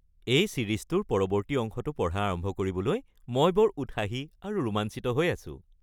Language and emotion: Assamese, happy